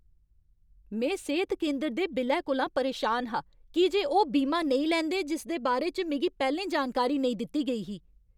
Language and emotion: Dogri, angry